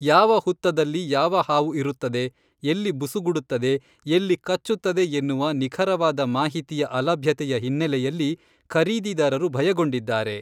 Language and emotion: Kannada, neutral